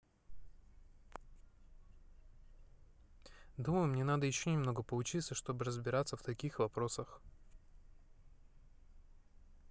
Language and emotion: Russian, neutral